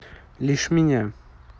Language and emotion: Russian, neutral